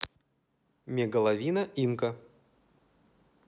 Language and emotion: Russian, neutral